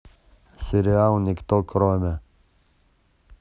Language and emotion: Russian, neutral